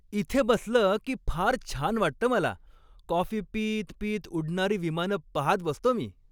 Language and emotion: Marathi, happy